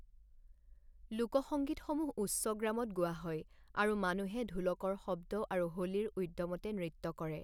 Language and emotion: Assamese, neutral